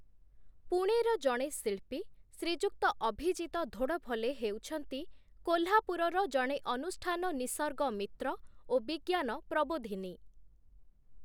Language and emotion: Odia, neutral